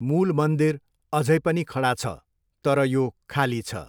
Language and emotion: Nepali, neutral